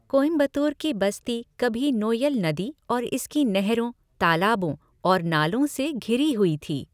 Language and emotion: Hindi, neutral